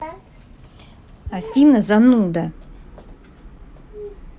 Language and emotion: Russian, angry